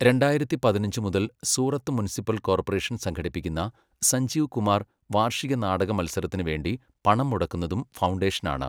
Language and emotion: Malayalam, neutral